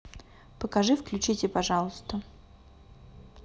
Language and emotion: Russian, neutral